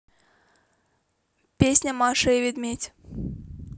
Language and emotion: Russian, neutral